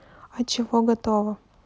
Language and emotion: Russian, neutral